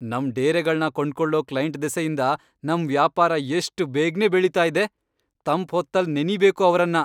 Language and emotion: Kannada, happy